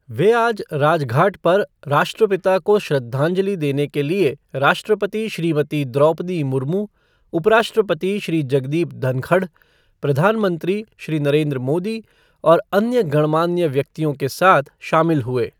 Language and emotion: Hindi, neutral